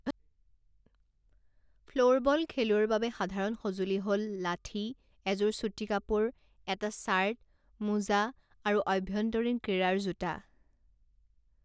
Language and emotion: Assamese, neutral